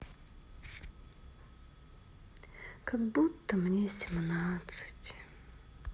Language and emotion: Russian, sad